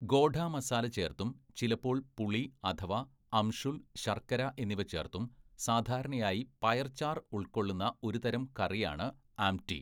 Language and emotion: Malayalam, neutral